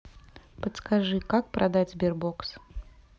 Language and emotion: Russian, neutral